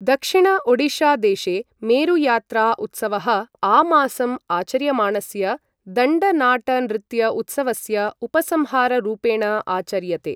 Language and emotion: Sanskrit, neutral